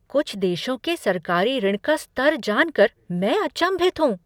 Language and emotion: Hindi, surprised